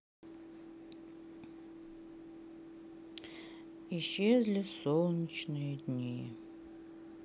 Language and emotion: Russian, sad